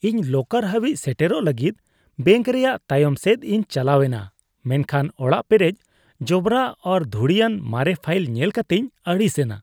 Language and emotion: Santali, disgusted